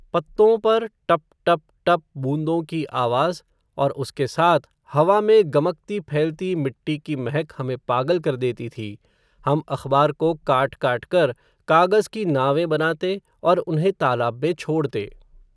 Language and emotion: Hindi, neutral